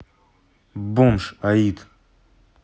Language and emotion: Russian, neutral